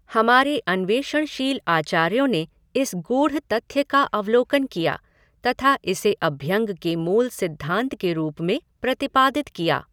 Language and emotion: Hindi, neutral